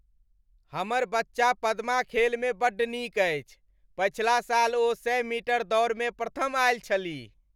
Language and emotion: Maithili, happy